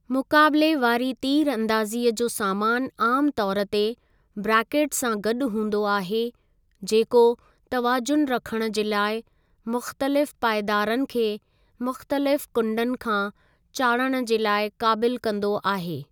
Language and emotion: Sindhi, neutral